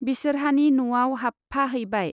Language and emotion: Bodo, neutral